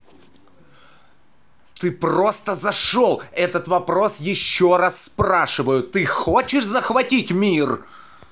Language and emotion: Russian, angry